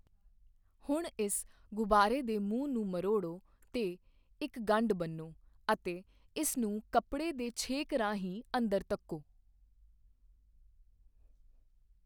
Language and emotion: Punjabi, neutral